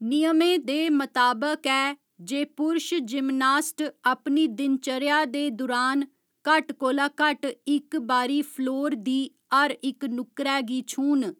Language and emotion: Dogri, neutral